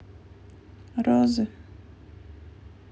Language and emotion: Russian, sad